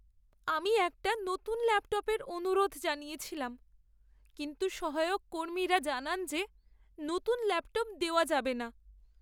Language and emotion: Bengali, sad